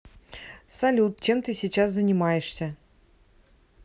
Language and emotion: Russian, neutral